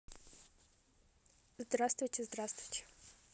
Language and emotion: Russian, neutral